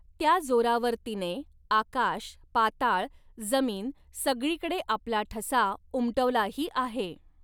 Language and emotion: Marathi, neutral